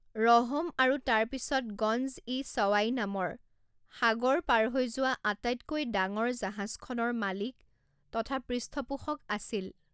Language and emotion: Assamese, neutral